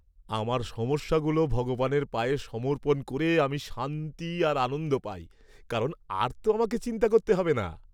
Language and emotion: Bengali, happy